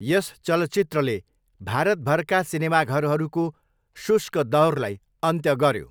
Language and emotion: Nepali, neutral